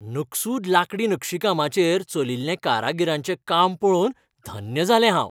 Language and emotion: Goan Konkani, happy